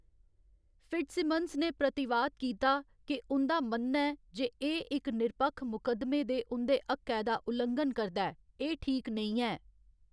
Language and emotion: Dogri, neutral